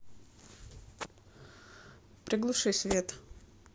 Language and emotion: Russian, neutral